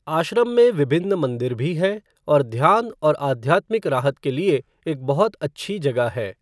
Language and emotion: Hindi, neutral